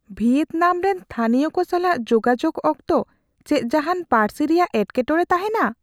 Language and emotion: Santali, fearful